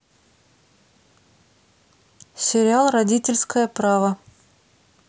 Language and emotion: Russian, neutral